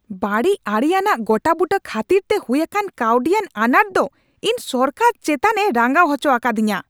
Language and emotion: Santali, angry